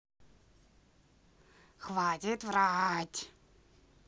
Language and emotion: Russian, angry